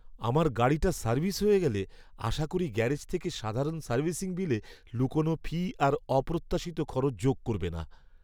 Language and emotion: Bengali, fearful